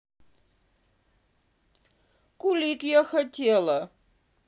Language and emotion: Russian, sad